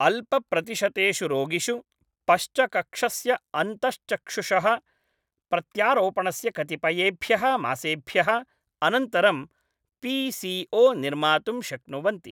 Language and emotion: Sanskrit, neutral